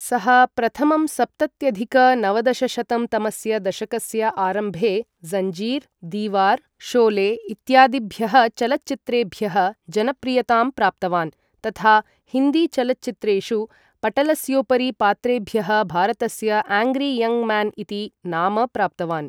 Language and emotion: Sanskrit, neutral